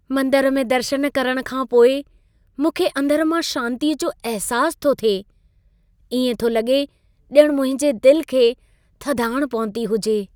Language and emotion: Sindhi, happy